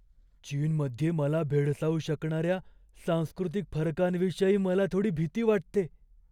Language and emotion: Marathi, fearful